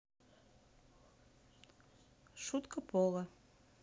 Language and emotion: Russian, neutral